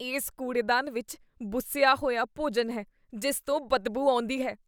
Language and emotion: Punjabi, disgusted